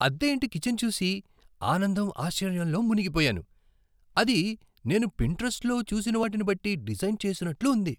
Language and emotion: Telugu, surprised